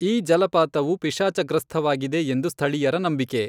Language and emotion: Kannada, neutral